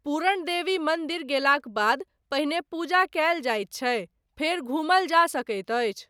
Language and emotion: Maithili, neutral